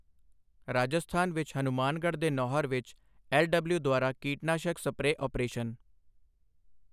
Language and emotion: Punjabi, neutral